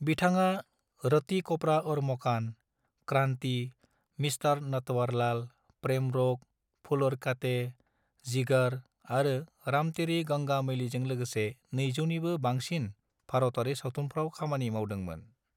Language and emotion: Bodo, neutral